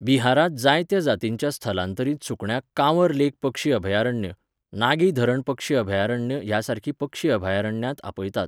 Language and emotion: Goan Konkani, neutral